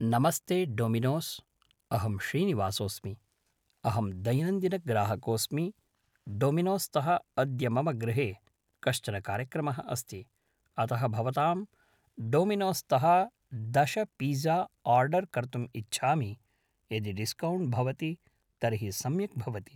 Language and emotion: Sanskrit, neutral